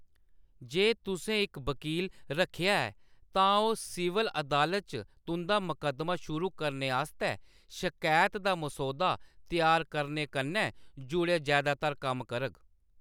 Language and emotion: Dogri, neutral